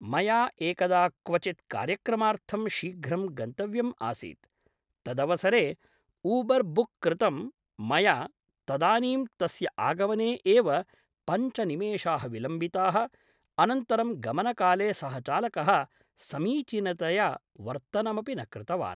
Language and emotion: Sanskrit, neutral